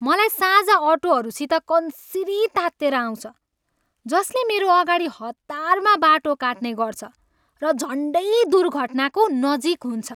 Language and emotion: Nepali, angry